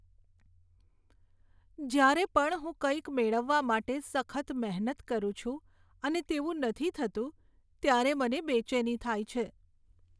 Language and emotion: Gujarati, sad